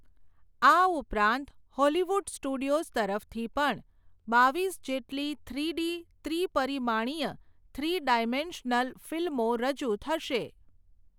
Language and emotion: Gujarati, neutral